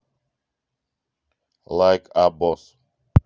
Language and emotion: Russian, neutral